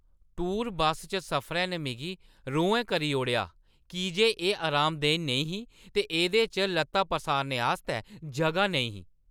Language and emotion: Dogri, angry